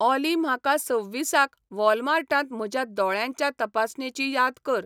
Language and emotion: Goan Konkani, neutral